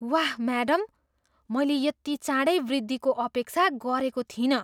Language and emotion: Nepali, surprised